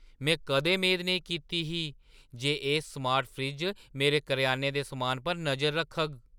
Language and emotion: Dogri, surprised